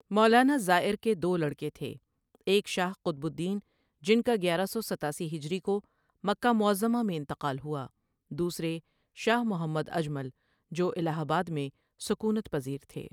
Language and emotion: Urdu, neutral